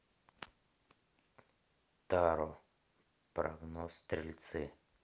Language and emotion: Russian, neutral